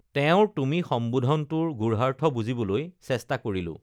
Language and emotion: Assamese, neutral